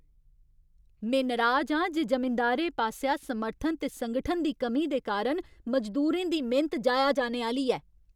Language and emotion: Dogri, angry